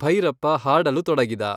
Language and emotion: Kannada, neutral